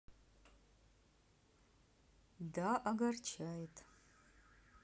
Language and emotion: Russian, neutral